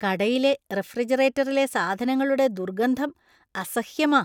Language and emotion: Malayalam, disgusted